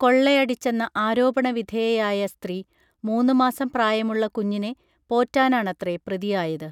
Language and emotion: Malayalam, neutral